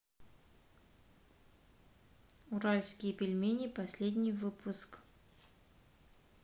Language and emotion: Russian, neutral